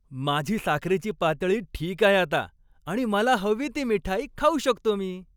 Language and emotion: Marathi, happy